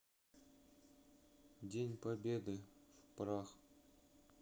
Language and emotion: Russian, neutral